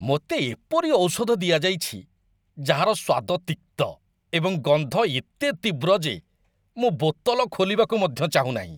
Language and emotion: Odia, disgusted